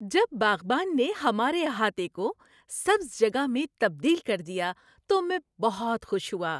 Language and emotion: Urdu, happy